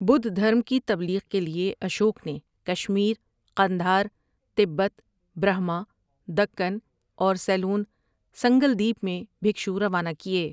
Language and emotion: Urdu, neutral